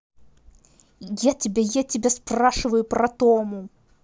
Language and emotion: Russian, angry